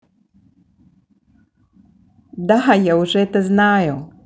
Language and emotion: Russian, positive